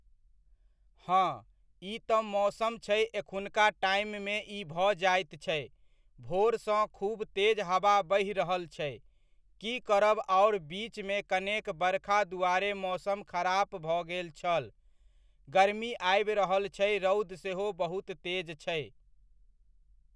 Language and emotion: Maithili, neutral